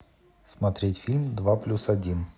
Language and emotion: Russian, neutral